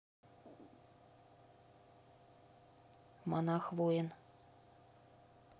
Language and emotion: Russian, neutral